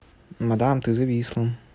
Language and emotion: Russian, neutral